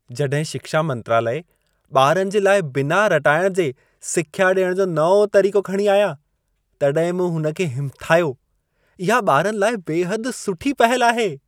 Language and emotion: Sindhi, happy